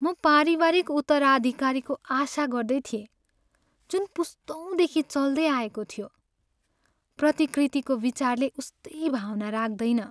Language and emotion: Nepali, sad